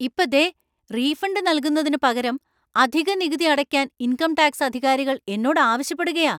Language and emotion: Malayalam, angry